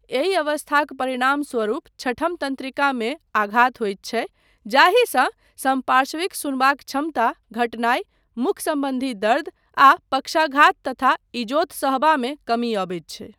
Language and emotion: Maithili, neutral